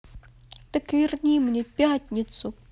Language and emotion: Russian, sad